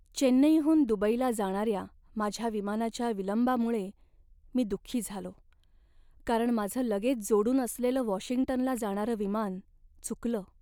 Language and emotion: Marathi, sad